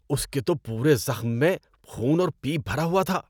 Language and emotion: Urdu, disgusted